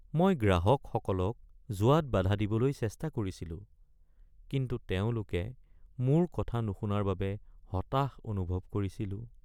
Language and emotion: Assamese, sad